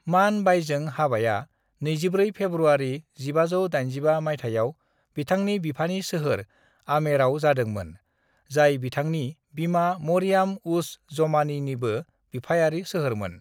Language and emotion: Bodo, neutral